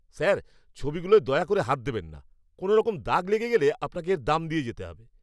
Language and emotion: Bengali, angry